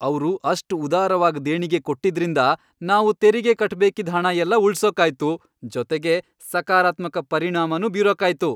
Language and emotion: Kannada, happy